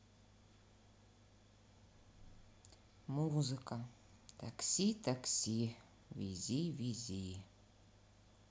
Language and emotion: Russian, neutral